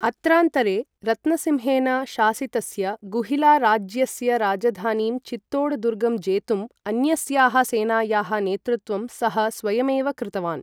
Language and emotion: Sanskrit, neutral